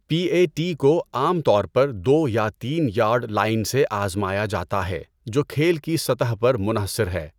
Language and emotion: Urdu, neutral